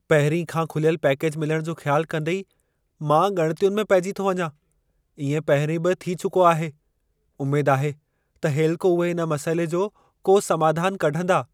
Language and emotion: Sindhi, fearful